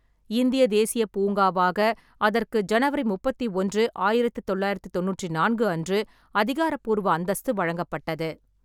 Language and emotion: Tamil, neutral